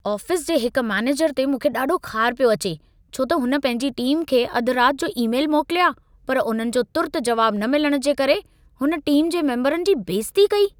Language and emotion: Sindhi, angry